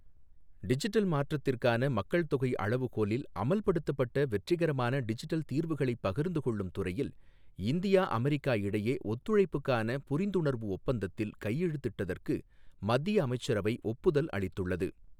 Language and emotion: Tamil, neutral